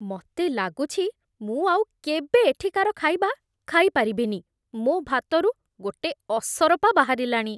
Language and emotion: Odia, disgusted